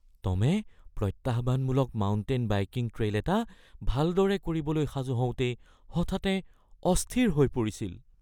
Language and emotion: Assamese, fearful